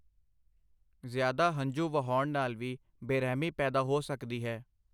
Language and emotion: Punjabi, neutral